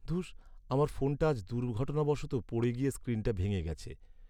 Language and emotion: Bengali, sad